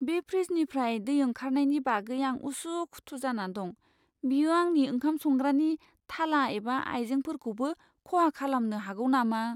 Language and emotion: Bodo, fearful